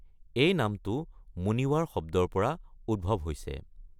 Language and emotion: Assamese, neutral